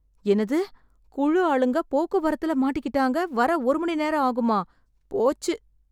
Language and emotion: Tamil, sad